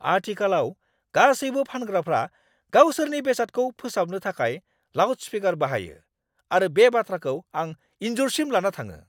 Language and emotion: Bodo, angry